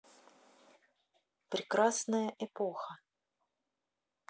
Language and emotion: Russian, neutral